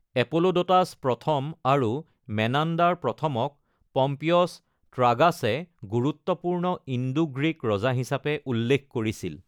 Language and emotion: Assamese, neutral